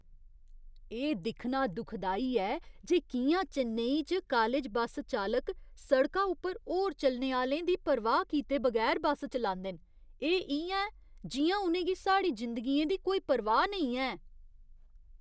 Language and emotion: Dogri, disgusted